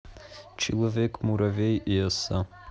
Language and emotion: Russian, neutral